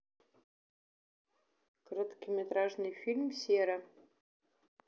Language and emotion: Russian, neutral